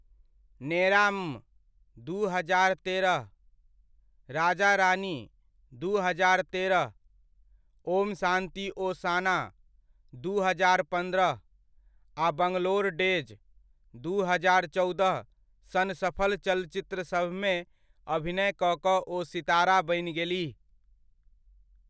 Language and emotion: Maithili, neutral